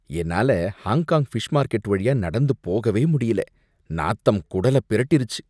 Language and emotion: Tamil, disgusted